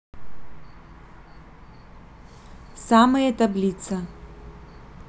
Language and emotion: Russian, neutral